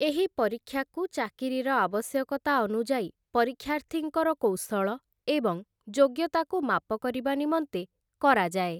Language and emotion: Odia, neutral